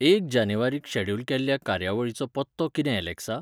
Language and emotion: Goan Konkani, neutral